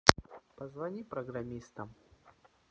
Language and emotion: Russian, neutral